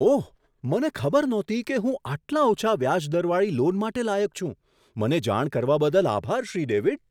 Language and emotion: Gujarati, surprised